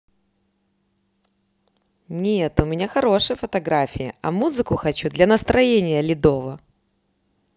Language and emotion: Russian, positive